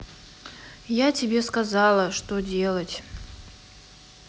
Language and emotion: Russian, sad